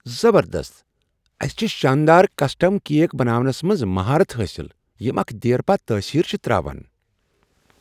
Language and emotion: Kashmiri, surprised